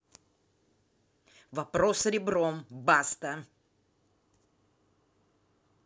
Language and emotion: Russian, angry